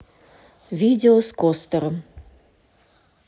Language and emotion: Russian, neutral